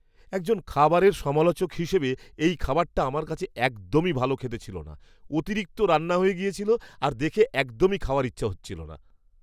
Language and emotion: Bengali, disgusted